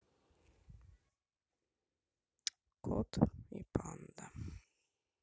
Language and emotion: Russian, sad